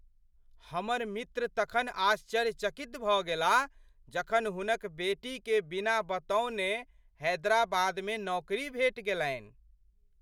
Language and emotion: Maithili, surprised